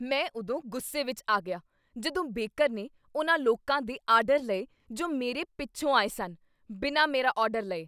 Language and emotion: Punjabi, angry